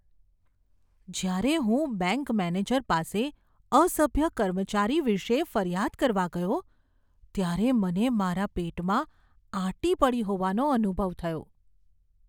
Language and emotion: Gujarati, fearful